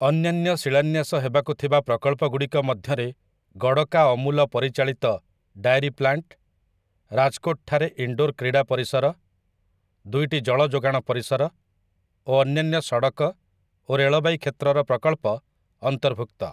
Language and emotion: Odia, neutral